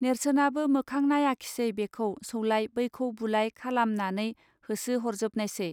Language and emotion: Bodo, neutral